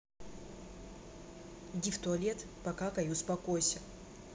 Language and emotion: Russian, neutral